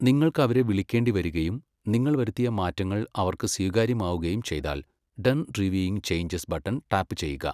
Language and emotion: Malayalam, neutral